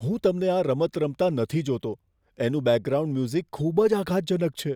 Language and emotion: Gujarati, fearful